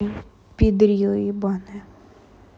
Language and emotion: Russian, neutral